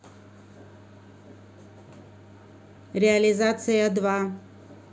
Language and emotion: Russian, neutral